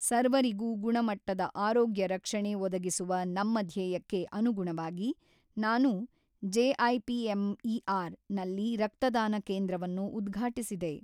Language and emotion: Kannada, neutral